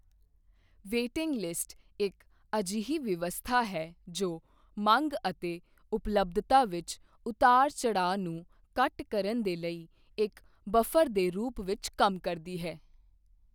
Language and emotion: Punjabi, neutral